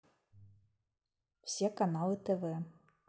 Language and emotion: Russian, neutral